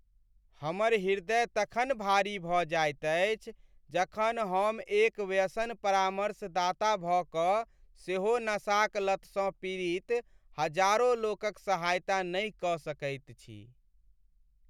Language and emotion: Maithili, sad